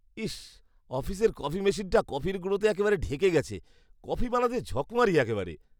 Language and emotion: Bengali, disgusted